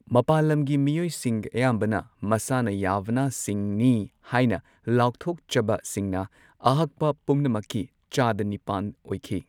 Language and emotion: Manipuri, neutral